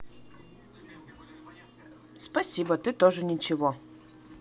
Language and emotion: Russian, neutral